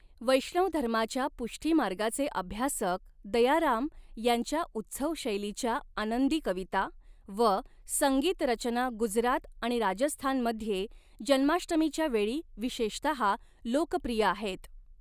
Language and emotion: Marathi, neutral